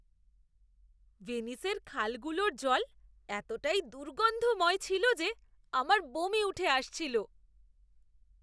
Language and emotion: Bengali, disgusted